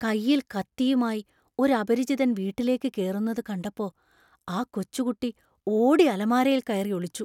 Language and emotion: Malayalam, fearful